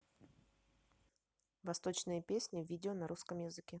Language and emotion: Russian, neutral